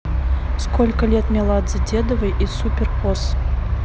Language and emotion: Russian, neutral